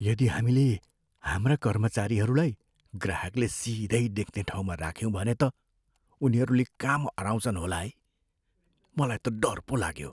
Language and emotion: Nepali, fearful